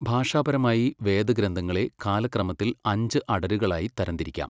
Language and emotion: Malayalam, neutral